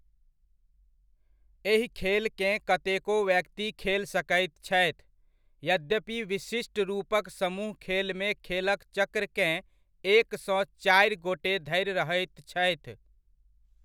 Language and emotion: Maithili, neutral